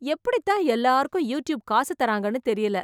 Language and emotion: Tamil, surprised